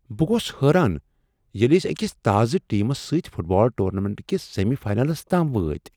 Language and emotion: Kashmiri, surprised